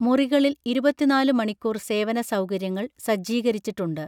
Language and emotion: Malayalam, neutral